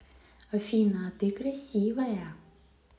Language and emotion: Russian, positive